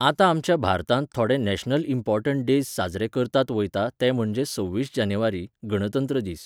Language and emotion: Goan Konkani, neutral